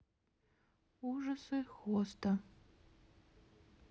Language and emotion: Russian, neutral